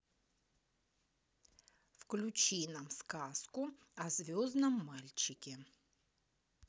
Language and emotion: Russian, neutral